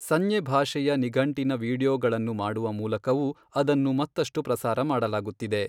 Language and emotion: Kannada, neutral